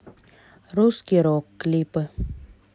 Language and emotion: Russian, neutral